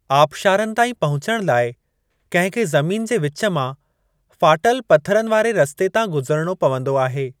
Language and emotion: Sindhi, neutral